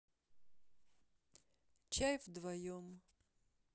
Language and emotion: Russian, sad